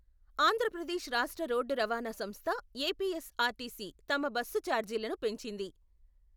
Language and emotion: Telugu, neutral